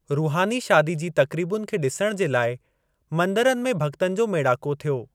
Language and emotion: Sindhi, neutral